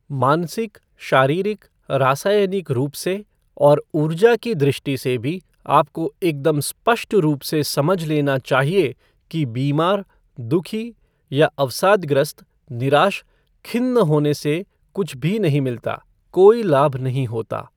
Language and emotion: Hindi, neutral